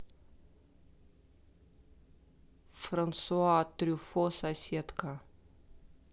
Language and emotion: Russian, neutral